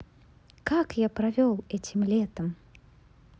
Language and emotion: Russian, positive